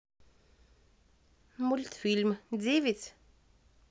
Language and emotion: Russian, neutral